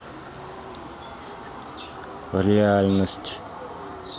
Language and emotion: Russian, neutral